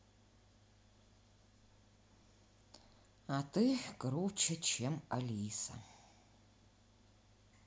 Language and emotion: Russian, sad